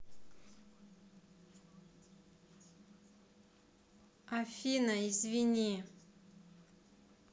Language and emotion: Russian, neutral